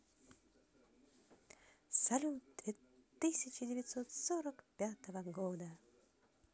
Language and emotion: Russian, positive